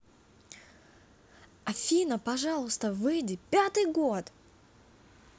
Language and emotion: Russian, positive